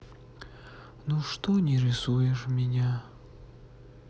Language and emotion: Russian, sad